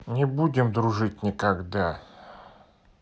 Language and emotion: Russian, angry